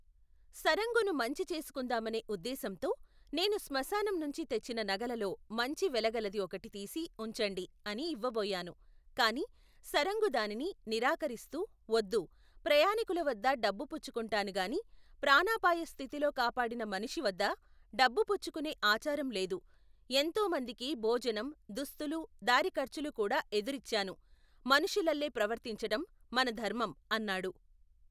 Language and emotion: Telugu, neutral